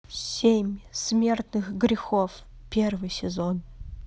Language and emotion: Russian, neutral